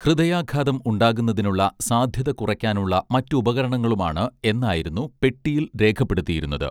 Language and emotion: Malayalam, neutral